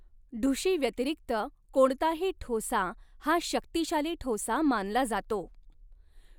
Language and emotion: Marathi, neutral